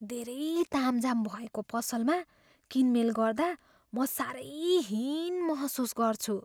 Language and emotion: Nepali, fearful